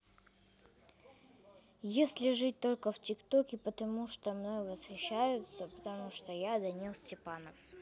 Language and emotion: Russian, neutral